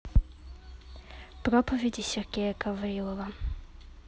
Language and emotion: Russian, neutral